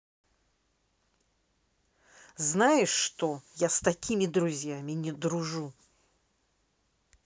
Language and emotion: Russian, angry